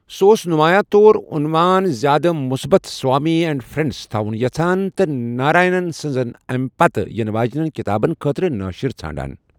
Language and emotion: Kashmiri, neutral